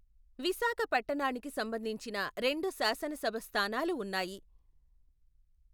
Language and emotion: Telugu, neutral